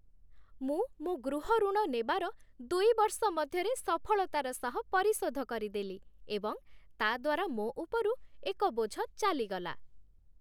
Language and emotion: Odia, happy